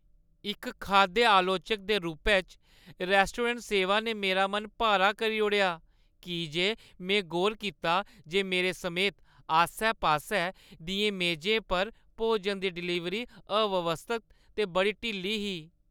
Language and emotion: Dogri, sad